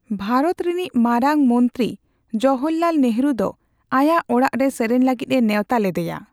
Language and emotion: Santali, neutral